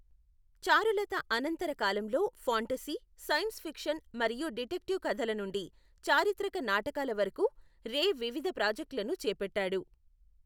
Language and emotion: Telugu, neutral